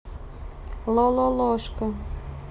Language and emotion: Russian, neutral